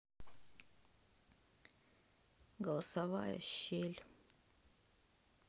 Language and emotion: Russian, sad